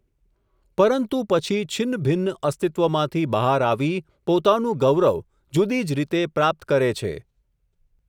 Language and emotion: Gujarati, neutral